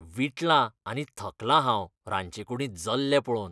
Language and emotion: Goan Konkani, disgusted